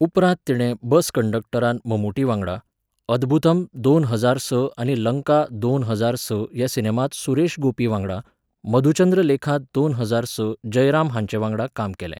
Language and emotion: Goan Konkani, neutral